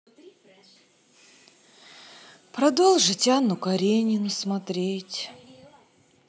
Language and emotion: Russian, sad